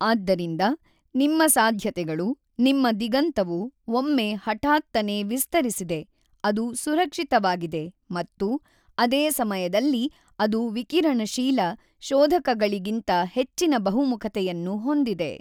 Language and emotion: Kannada, neutral